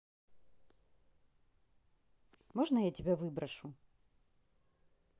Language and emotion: Russian, angry